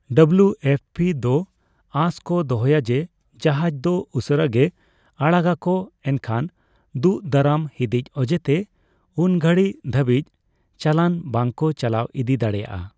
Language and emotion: Santali, neutral